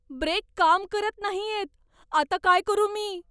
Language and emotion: Marathi, fearful